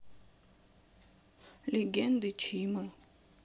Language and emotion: Russian, sad